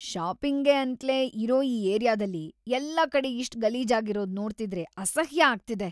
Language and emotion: Kannada, disgusted